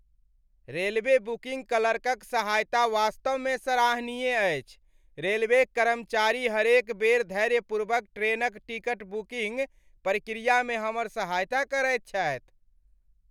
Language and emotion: Maithili, happy